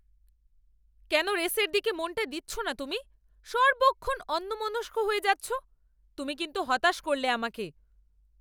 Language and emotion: Bengali, angry